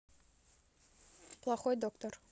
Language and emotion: Russian, neutral